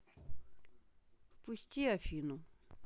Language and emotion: Russian, neutral